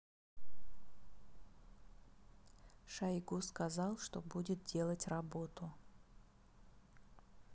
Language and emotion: Russian, neutral